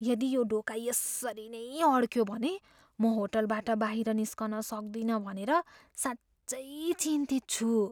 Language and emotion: Nepali, fearful